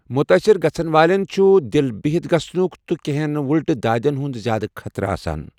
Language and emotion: Kashmiri, neutral